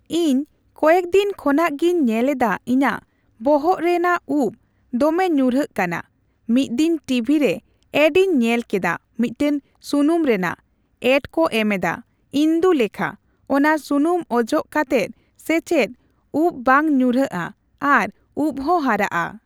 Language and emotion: Santali, neutral